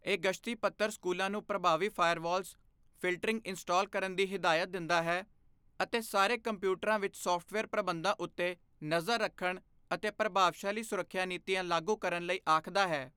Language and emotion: Punjabi, neutral